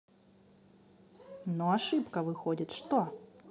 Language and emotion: Russian, neutral